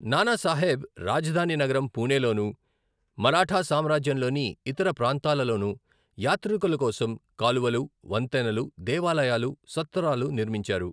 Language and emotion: Telugu, neutral